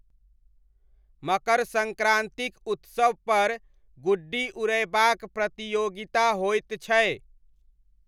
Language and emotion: Maithili, neutral